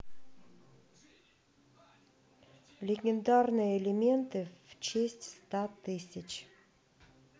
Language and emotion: Russian, neutral